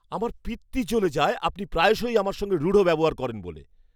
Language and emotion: Bengali, angry